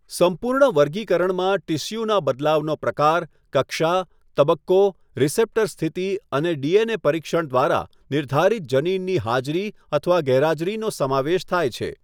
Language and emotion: Gujarati, neutral